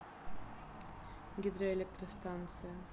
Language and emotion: Russian, neutral